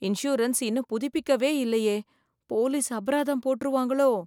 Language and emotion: Tamil, fearful